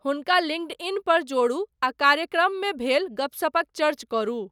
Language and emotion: Maithili, neutral